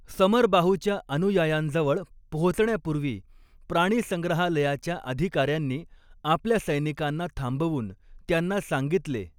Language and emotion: Marathi, neutral